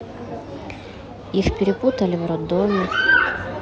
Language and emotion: Russian, neutral